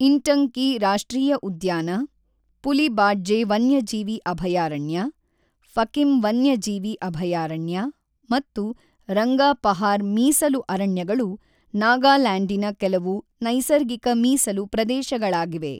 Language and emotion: Kannada, neutral